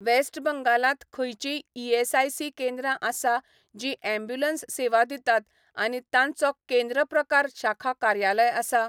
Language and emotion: Goan Konkani, neutral